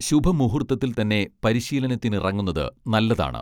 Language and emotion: Malayalam, neutral